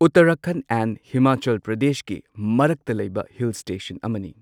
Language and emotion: Manipuri, neutral